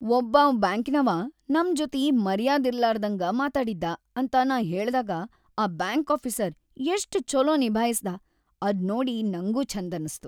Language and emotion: Kannada, happy